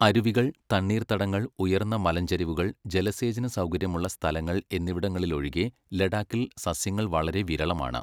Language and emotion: Malayalam, neutral